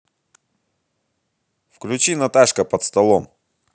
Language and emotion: Russian, positive